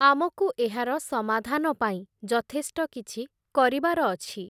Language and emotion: Odia, neutral